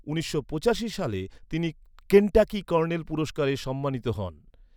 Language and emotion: Bengali, neutral